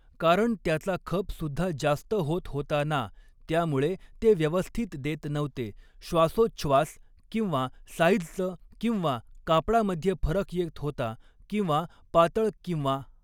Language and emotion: Marathi, neutral